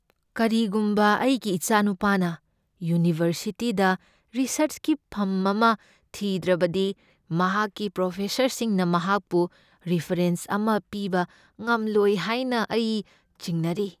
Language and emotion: Manipuri, fearful